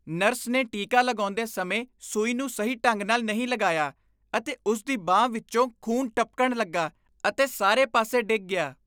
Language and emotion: Punjabi, disgusted